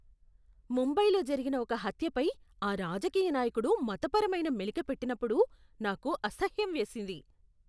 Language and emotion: Telugu, disgusted